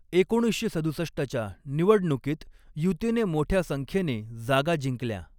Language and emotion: Marathi, neutral